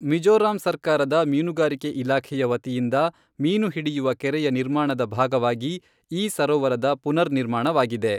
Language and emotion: Kannada, neutral